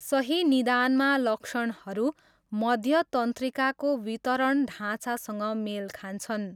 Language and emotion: Nepali, neutral